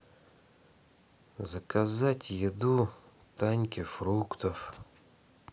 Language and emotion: Russian, sad